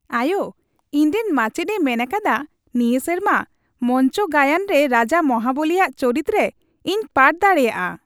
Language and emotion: Santali, happy